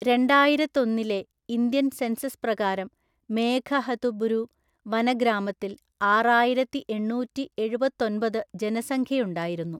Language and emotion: Malayalam, neutral